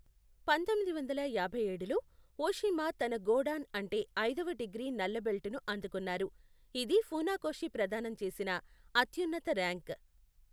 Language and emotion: Telugu, neutral